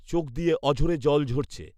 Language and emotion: Bengali, neutral